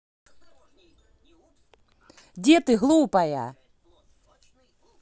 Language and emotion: Russian, angry